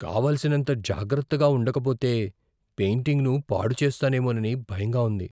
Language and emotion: Telugu, fearful